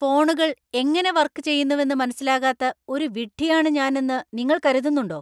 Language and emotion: Malayalam, angry